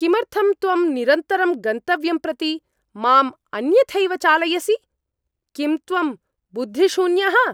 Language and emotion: Sanskrit, angry